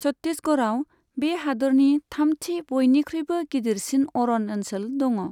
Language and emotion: Bodo, neutral